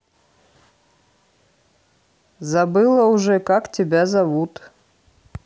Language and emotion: Russian, neutral